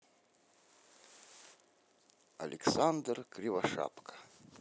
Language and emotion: Russian, positive